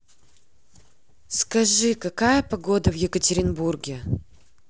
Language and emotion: Russian, neutral